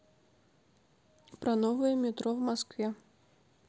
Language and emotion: Russian, neutral